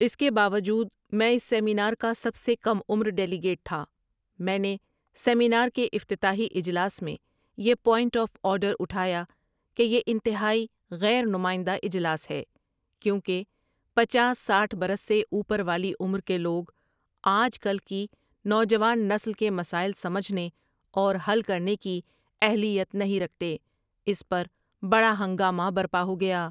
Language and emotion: Urdu, neutral